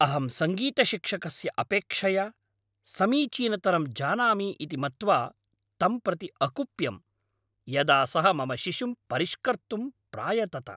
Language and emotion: Sanskrit, angry